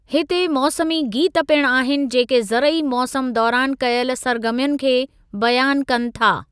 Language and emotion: Sindhi, neutral